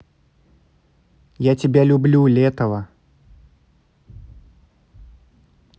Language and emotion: Russian, positive